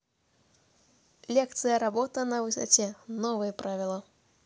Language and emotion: Russian, neutral